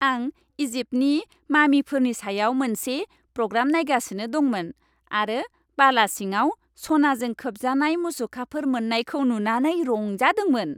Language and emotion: Bodo, happy